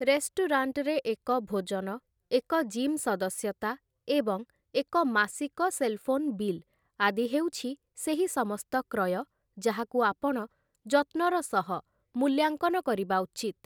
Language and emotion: Odia, neutral